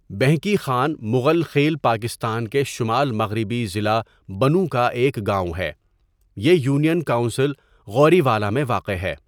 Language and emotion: Urdu, neutral